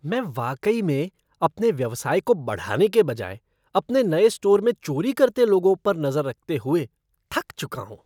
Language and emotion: Hindi, disgusted